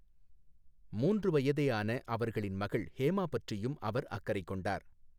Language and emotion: Tamil, neutral